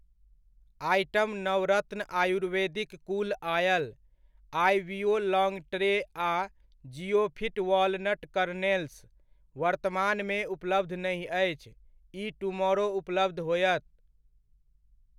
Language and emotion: Maithili, neutral